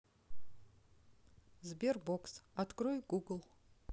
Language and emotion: Russian, neutral